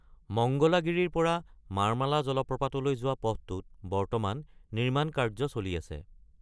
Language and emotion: Assamese, neutral